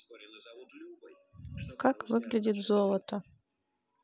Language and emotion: Russian, neutral